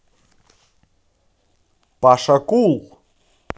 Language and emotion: Russian, positive